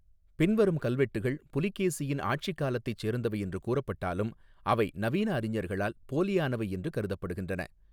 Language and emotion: Tamil, neutral